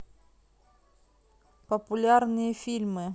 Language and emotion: Russian, neutral